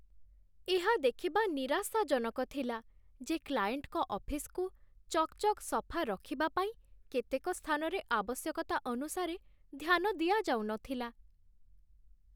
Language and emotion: Odia, sad